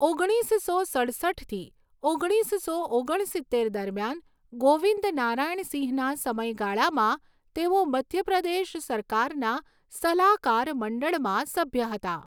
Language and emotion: Gujarati, neutral